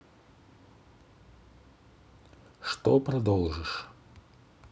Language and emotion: Russian, neutral